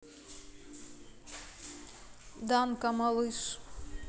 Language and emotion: Russian, neutral